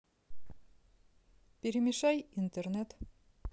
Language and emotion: Russian, neutral